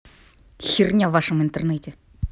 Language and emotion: Russian, angry